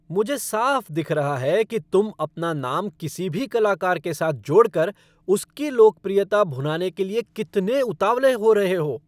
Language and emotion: Hindi, angry